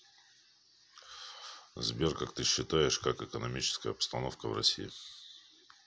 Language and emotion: Russian, neutral